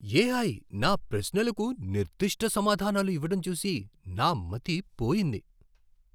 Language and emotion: Telugu, surprised